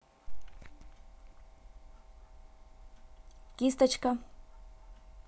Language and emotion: Russian, neutral